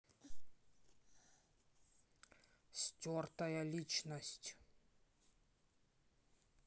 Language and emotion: Russian, angry